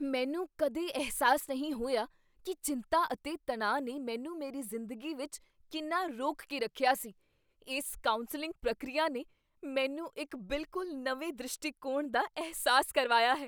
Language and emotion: Punjabi, surprised